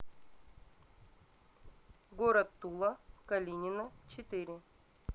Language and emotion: Russian, neutral